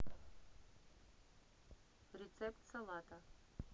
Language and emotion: Russian, neutral